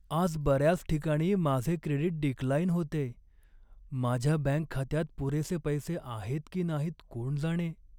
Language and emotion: Marathi, sad